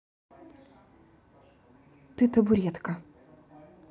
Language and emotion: Russian, neutral